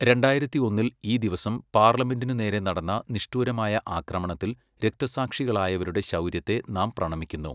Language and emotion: Malayalam, neutral